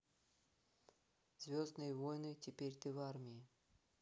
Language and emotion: Russian, neutral